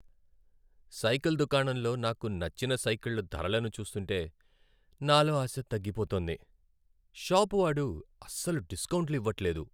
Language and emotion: Telugu, sad